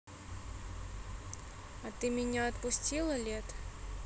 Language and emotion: Russian, neutral